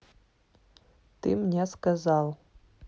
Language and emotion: Russian, neutral